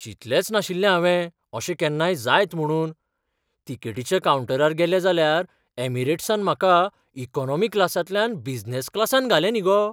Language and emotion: Goan Konkani, surprised